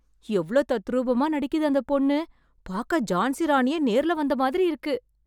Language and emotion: Tamil, surprised